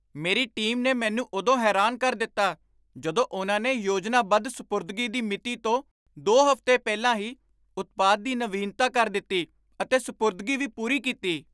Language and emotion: Punjabi, surprised